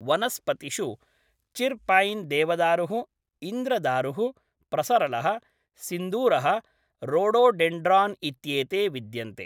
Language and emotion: Sanskrit, neutral